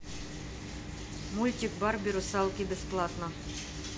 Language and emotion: Russian, neutral